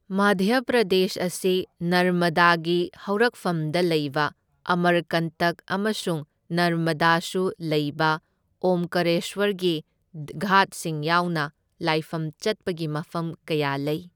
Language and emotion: Manipuri, neutral